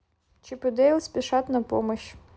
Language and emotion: Russian, neutral